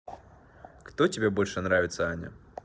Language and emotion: Russian, neutral